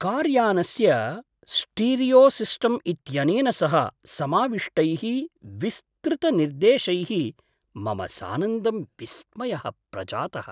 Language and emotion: Sanskrit, surprised